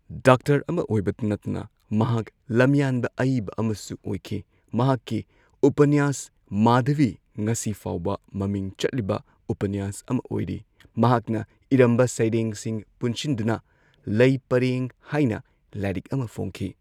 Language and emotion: Manipuri, neutral